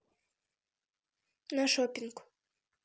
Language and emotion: Russian, neutral